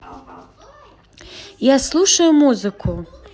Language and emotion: Russian, positive